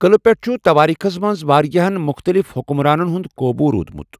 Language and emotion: Kashmiri, neutral